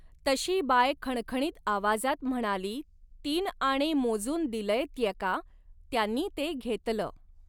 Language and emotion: Marathi, neutral